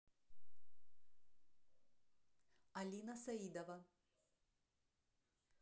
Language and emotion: Russian, neutral